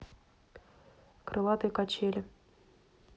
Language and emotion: Russian, neutral